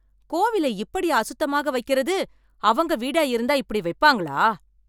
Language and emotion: Tamil, angry